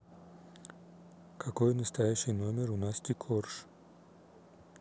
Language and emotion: Russian, neutral